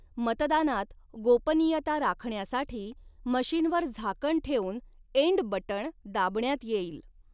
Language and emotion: Marathi, neutral